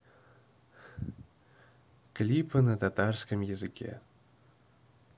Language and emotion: Russian, neutral